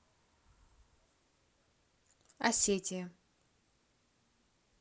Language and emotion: Russian, neutral